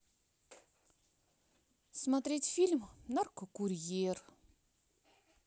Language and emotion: Russian, sad